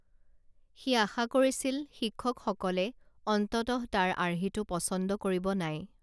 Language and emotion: Assamese, neutral